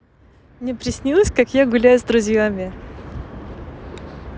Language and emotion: Russian, positive